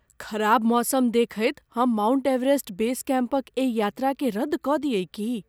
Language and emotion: Maithili, fearful